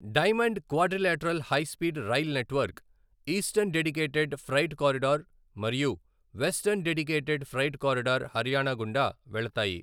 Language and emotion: Telugu, neutral